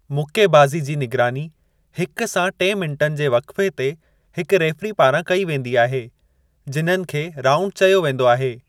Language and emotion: Sindhi, neutral